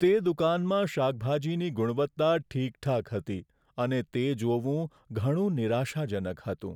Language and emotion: Gujarati, sad